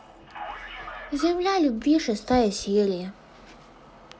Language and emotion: Russian, sad